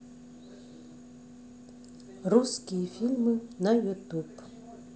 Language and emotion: Russian, neutral